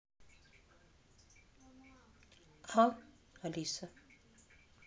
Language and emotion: Russian, neutral